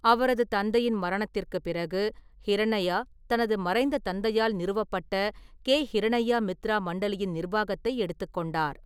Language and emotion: Tamil, neutral